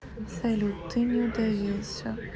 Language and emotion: Russian, neutral